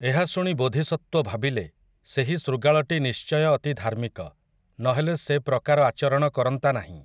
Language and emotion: Odia, neutral